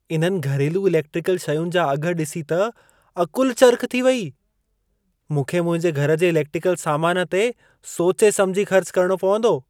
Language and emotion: Sindhi, surprised